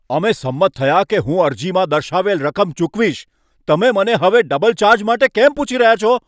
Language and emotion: Gujarati, angry